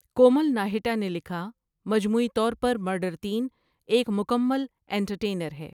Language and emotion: Urdu, neutral